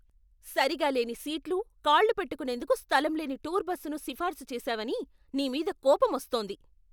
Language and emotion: Telugu, angry